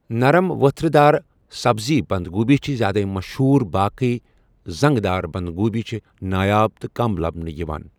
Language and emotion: Kashmiri, neutral